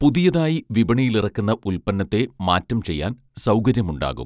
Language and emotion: Malayalam, neutral